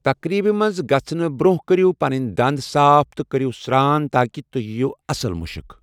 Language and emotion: Kashmiri, neutral